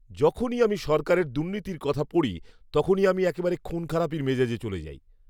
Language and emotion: Bengali, angry